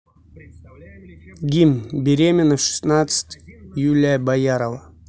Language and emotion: Russian, neutral